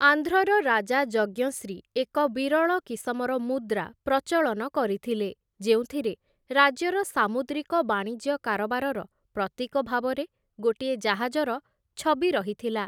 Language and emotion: Odia, neutral